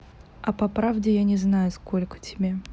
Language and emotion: Russian, neutral